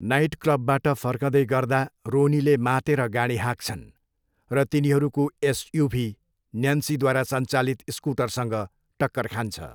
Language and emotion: Nepali, neutral